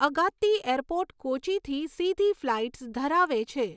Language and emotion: Gujarati, neutral